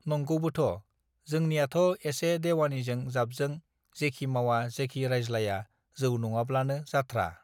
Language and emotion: Bodo, neutral